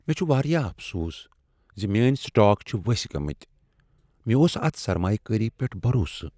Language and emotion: Kashmiri, sad